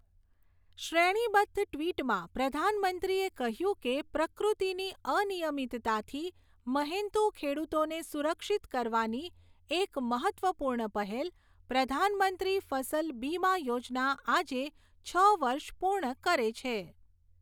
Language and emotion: Gujarati, neutral